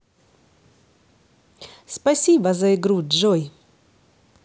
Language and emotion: Russian, positive